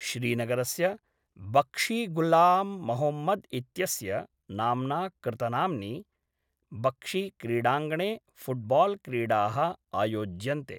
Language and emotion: Sanskrit, neutral